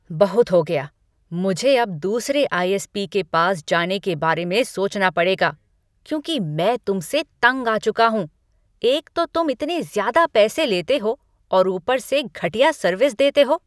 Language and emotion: Hindi, angry